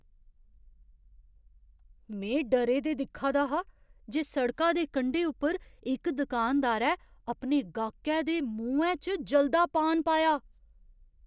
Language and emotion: Dogri, surprised